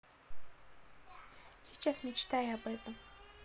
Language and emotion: Russian, neutral